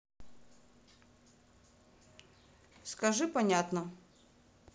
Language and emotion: Russian, neutral